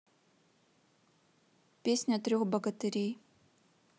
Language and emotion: Russian, neutral